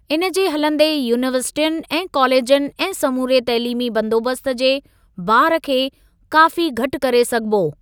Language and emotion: Sindhi, neutral